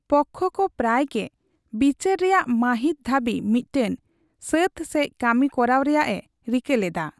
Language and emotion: Santali, neutral